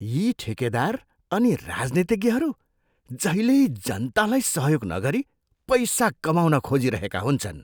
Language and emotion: Nepali, disgusted